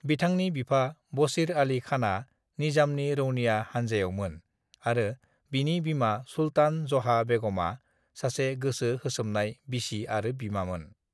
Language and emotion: Bodo, neutral